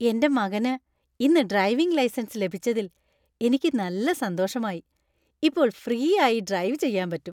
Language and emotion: Malayalam, happy